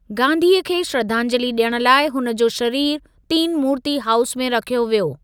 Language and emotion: Sindhi, neutral